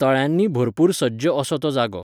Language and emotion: Goan Konkani, neutral